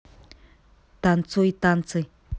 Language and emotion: Russian, positive